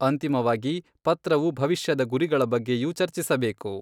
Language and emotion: Kannada, neutral